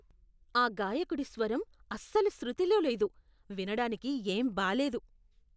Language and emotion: Telugu, disgusted